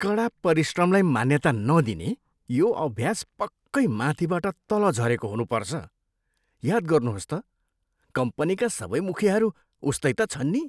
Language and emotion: Nepali, disgusted